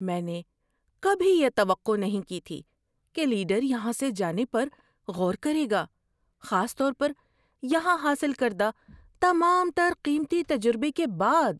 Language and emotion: Urdu, surprised